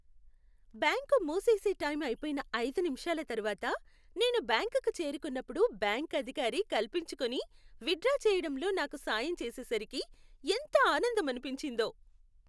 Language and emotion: Telugu, happy